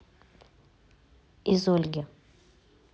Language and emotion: Russian, neutral